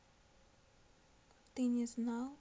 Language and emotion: Russian, sad